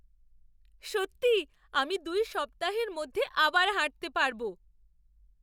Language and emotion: Bengali, surprised